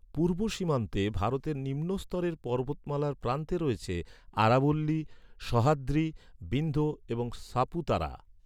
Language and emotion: Bengali, neutral